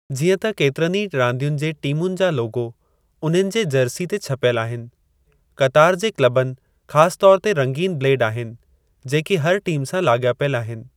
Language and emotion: Sindhi, neutral